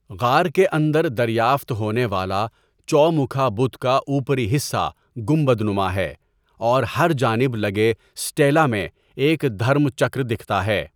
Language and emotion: Urdu, neutral